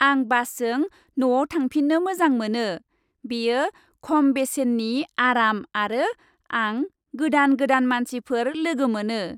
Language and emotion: Bodo, happy